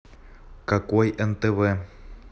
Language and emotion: Russian, angry